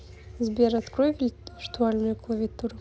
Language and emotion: Russian, neutral